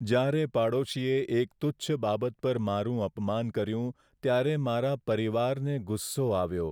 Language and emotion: Gujarati, sad